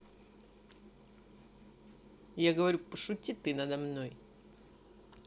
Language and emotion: Russian, neutral